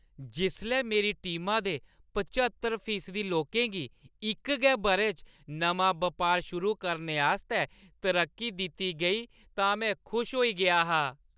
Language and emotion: Dogri, happy